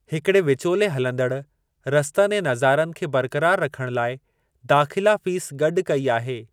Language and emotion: Sindhi, neutral